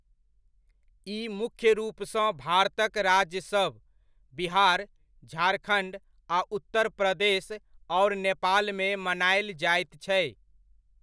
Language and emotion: Maithili, neutral